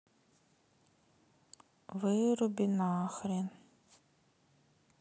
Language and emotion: Russian, sad